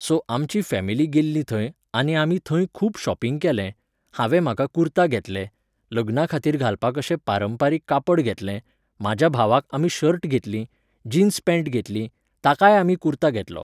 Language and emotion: Goan Konkani, neutral